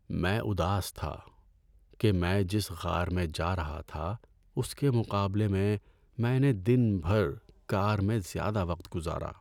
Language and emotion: Urdu, sad